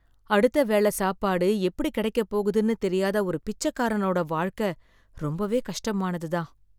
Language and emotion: Tamil, sad